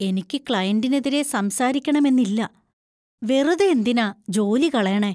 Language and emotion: Malayalam, fearful